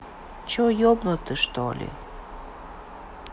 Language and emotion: Russian, sad